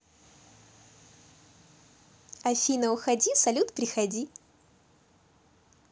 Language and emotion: Russian, positive